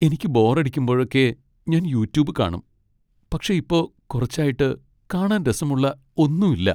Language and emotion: Malayalam, sad